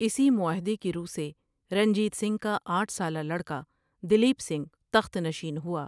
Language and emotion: Urdu, neutral